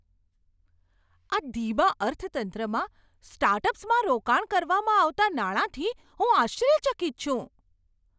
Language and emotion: Gujarati, surprised